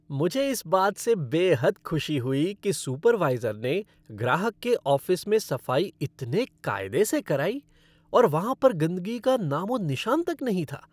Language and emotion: Hindi, happy